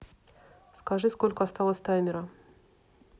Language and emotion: Russian, neutral